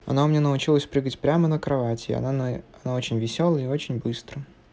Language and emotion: Russian, neutral